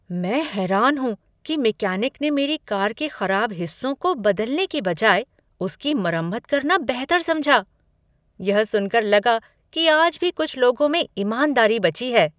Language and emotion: Hindi, surprised